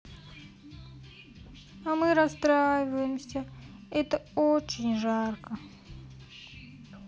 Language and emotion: Russian, sad